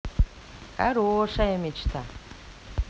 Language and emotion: Russian, positive